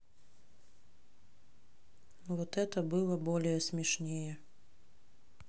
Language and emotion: Russian, neutral